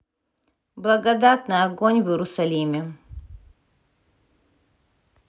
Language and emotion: Russian, neutral